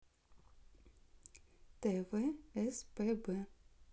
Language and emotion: Russian, neutral